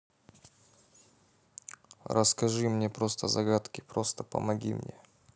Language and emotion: Russian, neutral